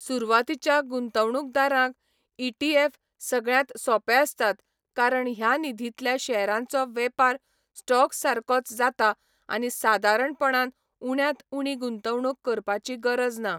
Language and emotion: Goan Konkani, neutral